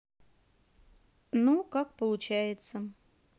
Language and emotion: Russian, neutral